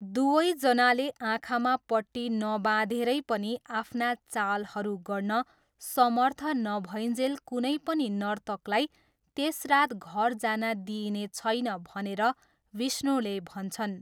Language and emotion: Nepali, neutral